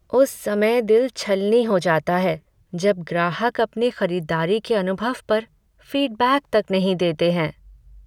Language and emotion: Hindi, sad